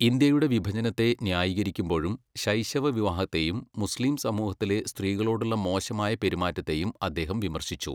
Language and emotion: Malayalam, neutral